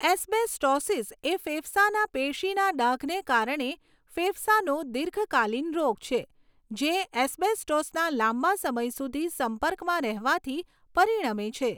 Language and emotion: Gujarati, neutral